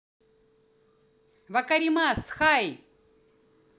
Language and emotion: Russian, positive